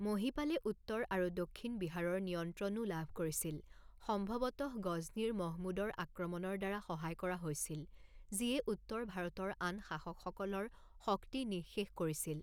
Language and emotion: Assamese, neutral